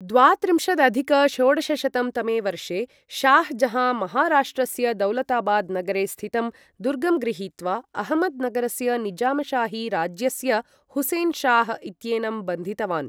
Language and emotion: Sanskrit, neutral